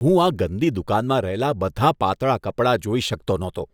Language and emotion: Gujarati, disgusted